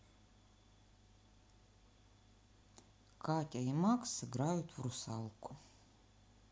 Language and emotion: Russian, neutral